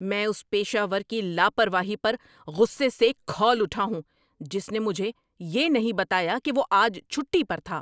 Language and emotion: Urdu, angry